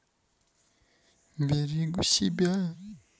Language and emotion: Russian, neutral